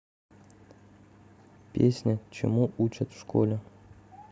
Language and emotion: Russian, neutral